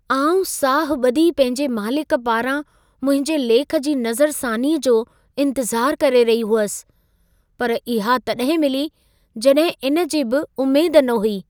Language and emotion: Sindhi, surprised